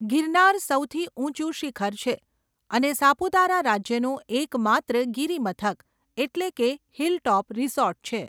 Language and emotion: Gujarati, neutral